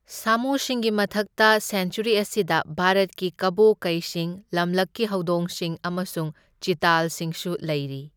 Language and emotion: Manipuri, neutral